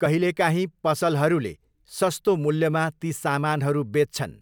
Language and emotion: Nepali, neutral